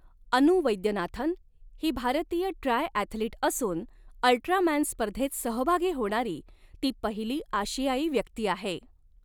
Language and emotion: Marathi, neutral